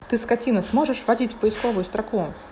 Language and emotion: Russian, angry